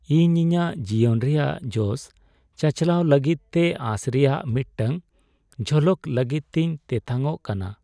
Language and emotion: Santali, sad